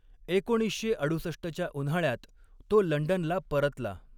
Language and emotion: Marathi, neutral